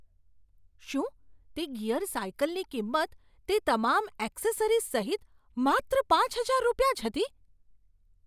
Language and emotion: Gujarati, surprised